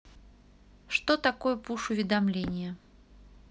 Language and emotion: Russian, neutral